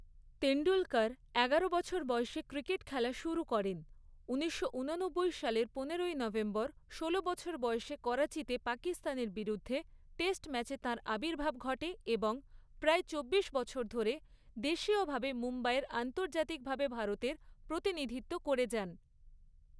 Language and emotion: Bengali, neutral